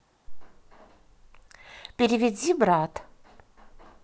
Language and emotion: Russian, neutral